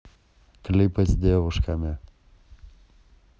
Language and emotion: Russian, neutral